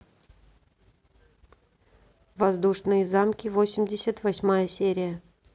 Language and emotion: Russian, neutral